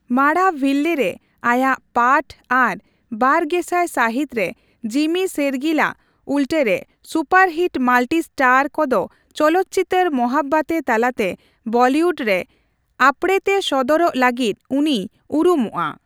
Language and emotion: Santali, neutral